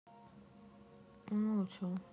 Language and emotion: Russian, sad